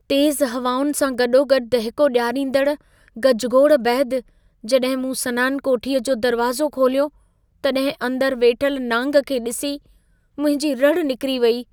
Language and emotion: Sindhi, fearful